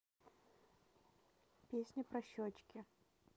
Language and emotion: Russian, neutral